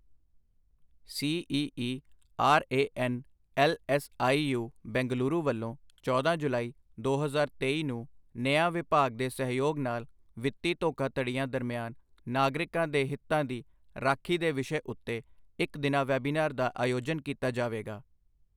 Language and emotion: Punjabi, neutral